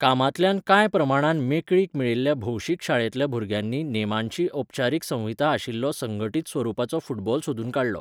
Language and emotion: Goan Konkani, neutral